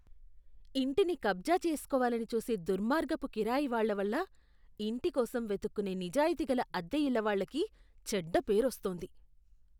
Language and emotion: Telugu, disgusted